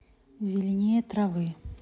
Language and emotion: Russian, neutral